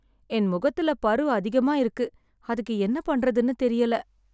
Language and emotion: Tamil, sad